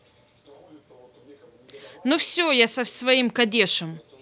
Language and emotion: Russian, neutral